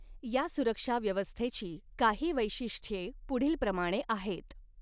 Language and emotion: Marathi, neutral